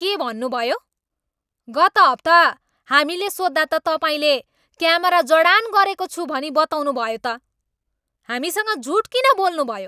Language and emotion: Nepali, angry